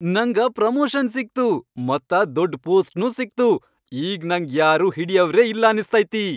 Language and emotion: Kannada, happy